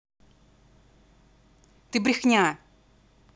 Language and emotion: Russian, angry